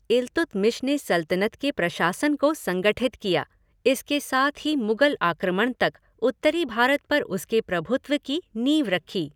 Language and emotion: Hindi, neutral